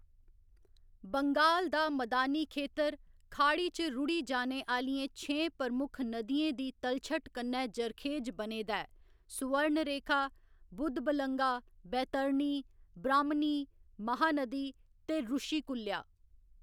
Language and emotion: Dogri, neutral